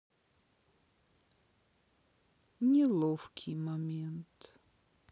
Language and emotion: Russian, sad